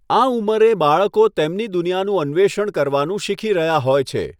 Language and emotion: Gujarati, neutral